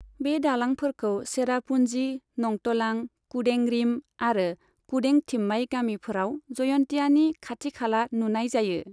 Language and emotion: Bodo, neutral